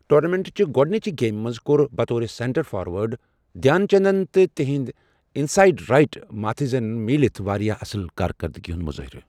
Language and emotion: Kashmiri, neutral